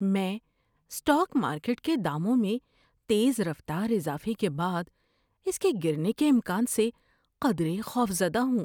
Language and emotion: Urdu, fearful